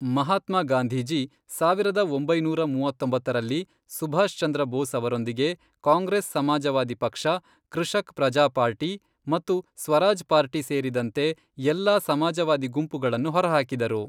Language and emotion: Kannada, neutral